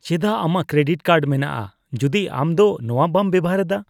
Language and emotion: Santali, disgusted